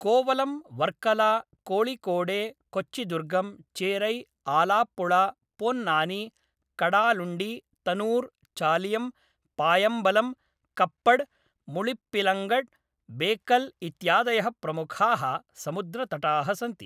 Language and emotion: Sanskrit, neutral